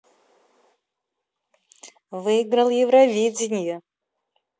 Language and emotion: Russian, positive